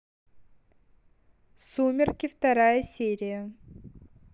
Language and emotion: Russian, neutral